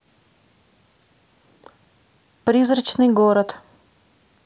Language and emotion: Russian, neutral